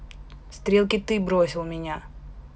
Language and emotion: Russian, neutral